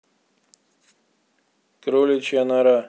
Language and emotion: Russian, neutral